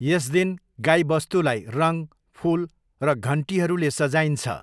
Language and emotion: Nepali, neutral